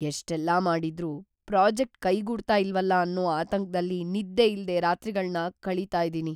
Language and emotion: Kannada, fearful